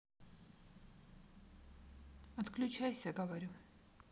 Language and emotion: Russian, neutral